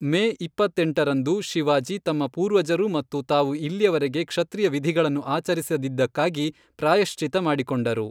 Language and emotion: Kannada, neutral